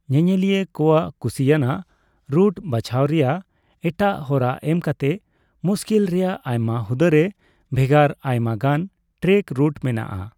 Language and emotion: Santali, neutral